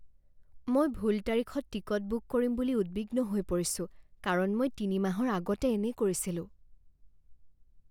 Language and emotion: Assamese, fearful